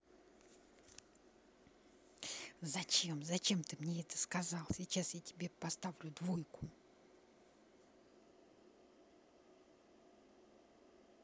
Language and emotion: Russian, angry